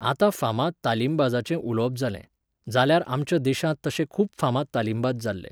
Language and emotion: Goan Konkani, neutral